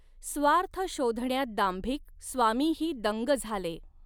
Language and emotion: Marathi, neutral